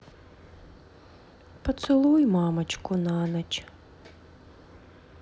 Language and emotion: Russian, sad